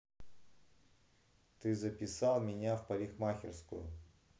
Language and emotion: Russian, angry